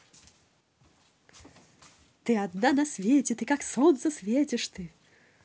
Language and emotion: Russian, positive